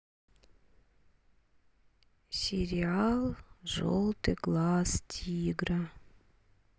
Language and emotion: Russian, sad